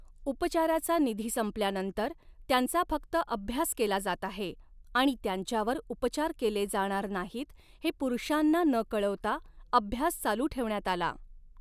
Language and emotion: Marathi, neutral